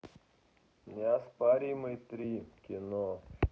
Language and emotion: Russian, neutral